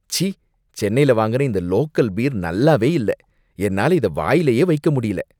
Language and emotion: Tamil, disgusted